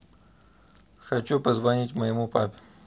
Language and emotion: Russian, neutral